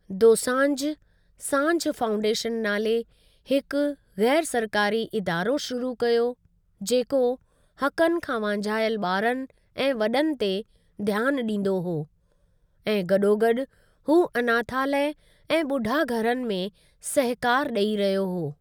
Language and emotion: Sindhi, neutral